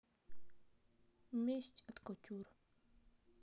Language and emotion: Russian, sad